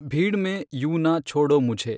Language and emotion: Kannada, neutral